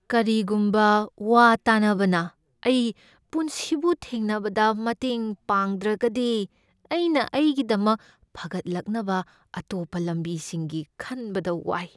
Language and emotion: Manipuri, fearful